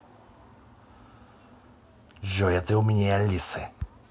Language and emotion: Russian, angry